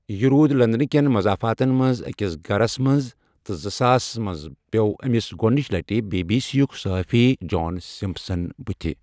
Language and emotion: Kashmiri, neutral